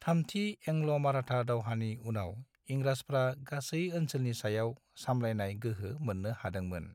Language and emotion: Bodo, neutral